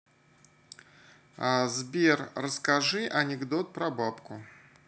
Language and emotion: Russian, neutral